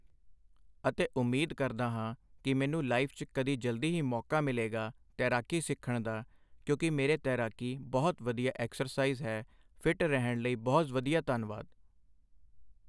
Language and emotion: Punjabi, neutral